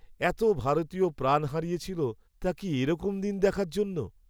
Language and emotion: Bengali, sad